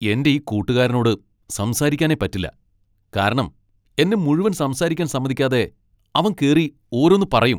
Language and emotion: Malayalam, angry